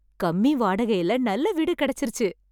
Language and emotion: Tamil, happy